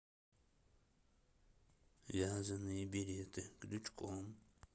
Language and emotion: Russian, neutral